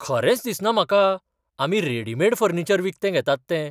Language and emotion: Goan Konkani, surprised